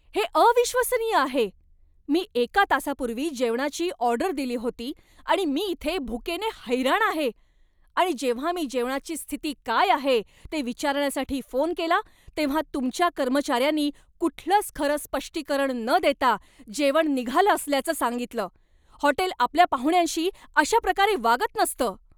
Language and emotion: Marathi, angry